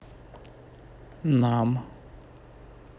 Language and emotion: Russian, neutral